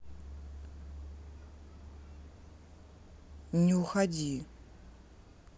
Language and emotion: Russian, neutral